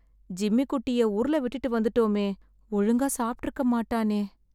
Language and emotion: Tamil, sad